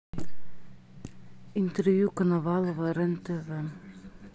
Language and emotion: Russian, neutral